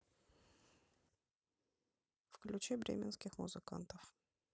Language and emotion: Russian, neutral